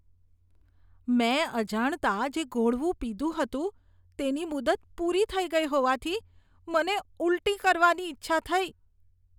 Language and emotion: Gujarati, disgusted